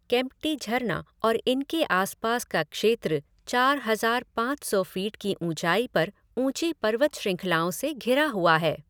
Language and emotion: Hindi, neutral